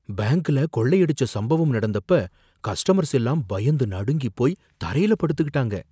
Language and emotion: Tamil, fearful